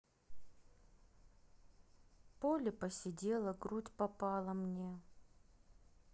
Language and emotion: Russian, sad